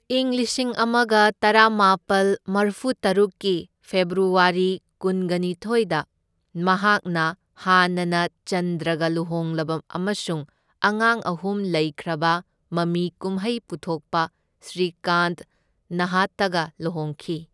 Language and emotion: Manipuri, neutral